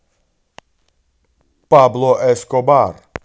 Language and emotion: Russian, positive